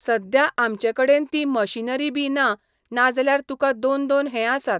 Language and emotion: Goan Konkani, neutral